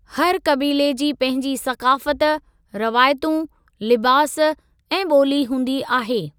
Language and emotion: Sindhi, neutral